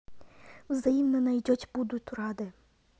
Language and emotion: Russian, neutral